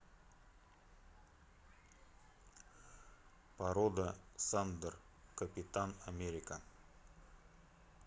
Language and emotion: Russian, neutral